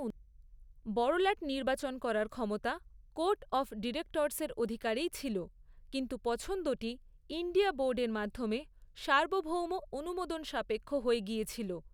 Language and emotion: Bengali, neutral